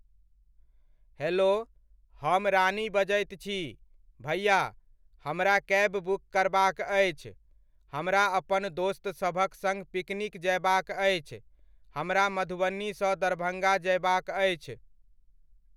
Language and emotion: Maithili, neutral